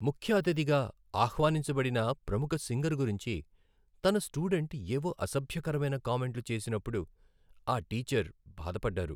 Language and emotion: Telugu, sad